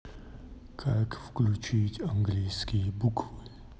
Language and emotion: Russian, sad